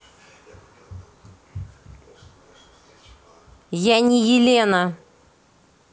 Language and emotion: Russian, angry